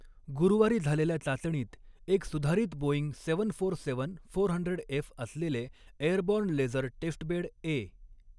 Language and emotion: Marathi, neutral